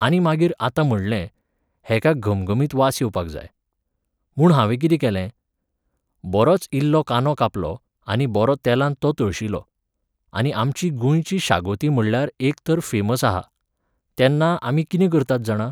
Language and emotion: Goan Konkani, neutral